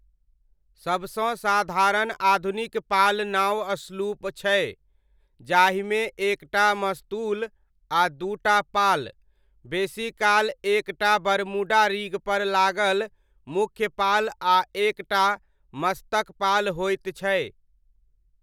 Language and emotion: Maithili, neutral